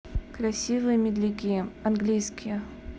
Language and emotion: Russian, neutral